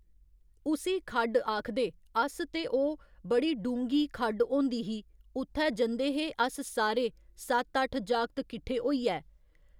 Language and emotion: Dogri, neutral